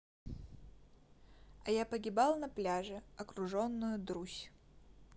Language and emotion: Russian, neutral